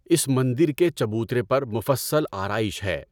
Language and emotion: Urdu, neutral